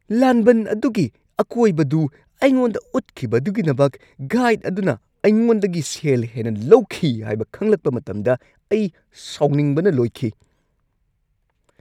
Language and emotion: Manipuri, angry